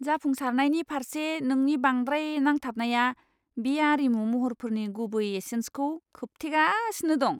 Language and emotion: Bodo, disgusted